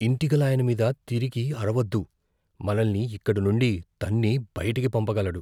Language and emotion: Telugu, fearful